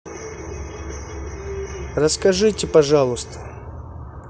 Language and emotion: Russian, neutral